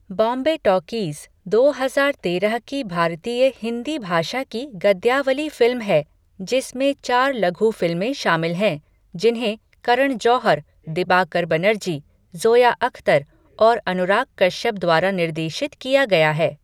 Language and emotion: Hindi, neutral